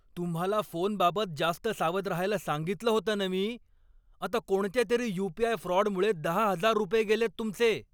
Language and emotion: Marathi, angry